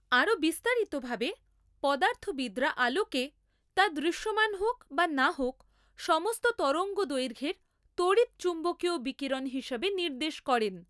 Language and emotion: Bengali, neutral